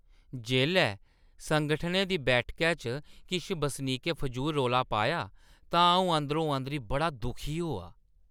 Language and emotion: Dogri, disgusted